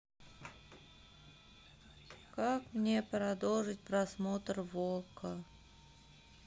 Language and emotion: Russian, sad